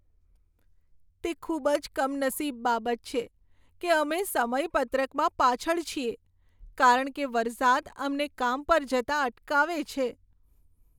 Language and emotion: Gujarati, sad